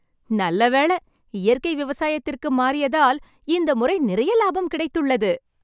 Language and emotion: Tamil, happy